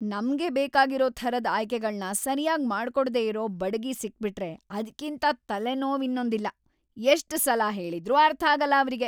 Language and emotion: Kannada, angry